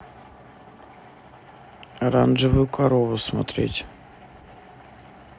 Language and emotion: Russian, neutral